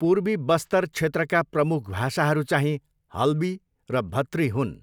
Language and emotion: Nepali, neutral